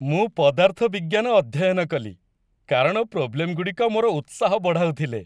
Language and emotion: Odia, happy